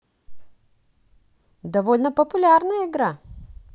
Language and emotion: Russian, positive